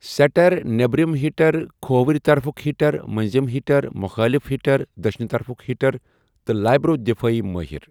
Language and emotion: Kashmiri, neutral